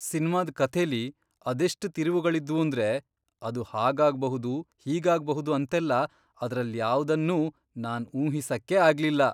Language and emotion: Kannada, surprised